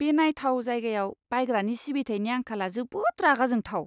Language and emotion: Bodo, disgusted